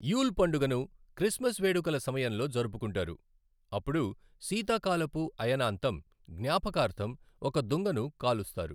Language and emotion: Telugu, neutral